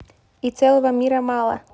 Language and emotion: Russian, neutral